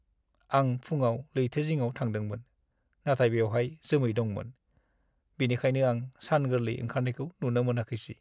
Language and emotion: Bodo, sad